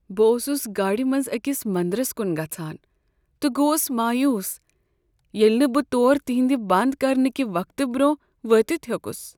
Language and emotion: Kashmiri, sad